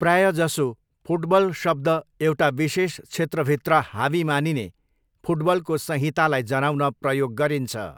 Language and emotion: Nepali, neutral